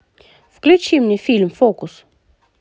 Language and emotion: Russian, positive